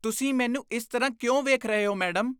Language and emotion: Punjabi, disgusted